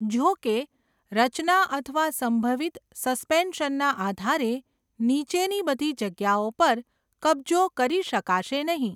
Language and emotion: Gujarati, neutral